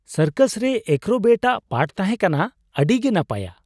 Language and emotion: Santali, surprised